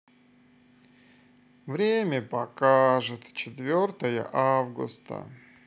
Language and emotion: Russian, sad